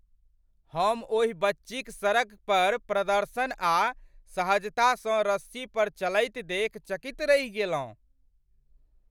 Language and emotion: Maithili, surprised